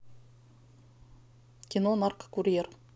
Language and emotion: Russian, neutral